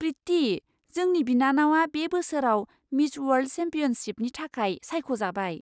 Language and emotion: Bodo, surprised